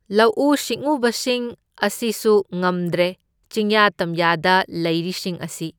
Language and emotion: Manipuri, neutral